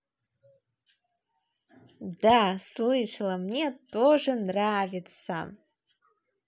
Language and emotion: Russian, positive